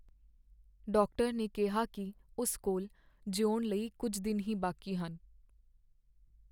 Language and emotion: Punjabi, sad